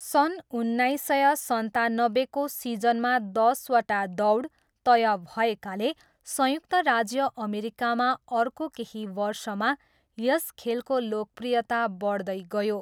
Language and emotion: Nepali, neutral